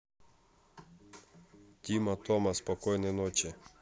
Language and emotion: Russian, neutral